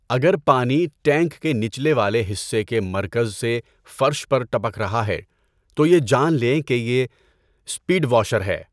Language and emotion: Urdu, neutral